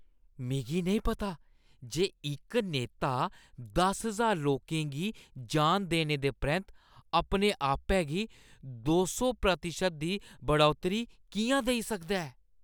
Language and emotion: Dogri, disgusted